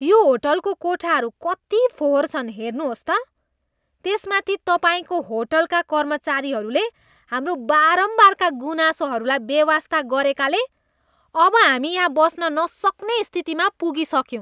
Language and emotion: Nepali, disgusted